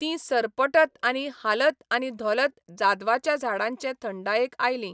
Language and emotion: Goan Konkani, neutral